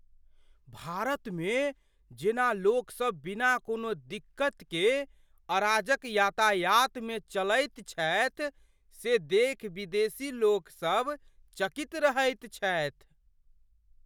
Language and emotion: Maithili, surprised